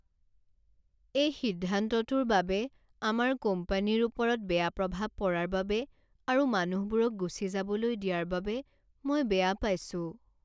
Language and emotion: Assamese, sad